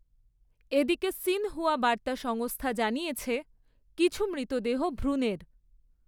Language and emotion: Bengali, neutral